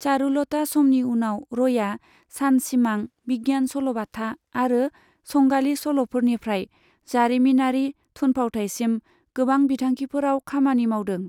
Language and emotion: Bodo, neutral